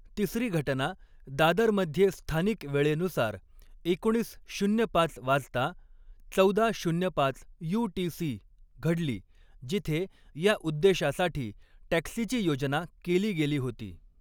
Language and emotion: Marathi, neutral